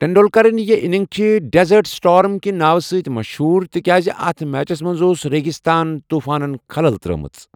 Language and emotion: Kashmiri, neutral